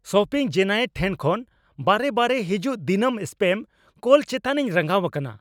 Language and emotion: Santali, angry